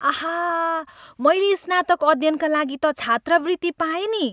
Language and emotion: Nepali, happy